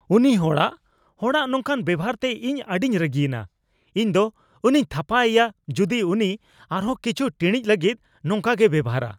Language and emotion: Santali, angry